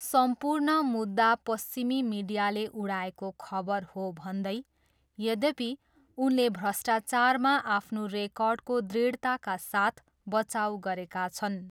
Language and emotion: Nepali, neutral